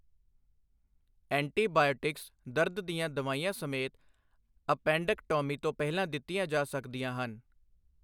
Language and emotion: Punjabi, neutral